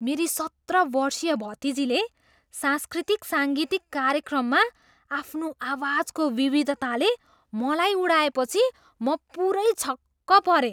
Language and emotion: Nepali, surprised